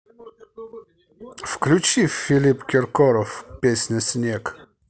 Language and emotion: Russian, positive